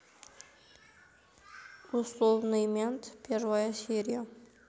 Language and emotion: Russian, neutral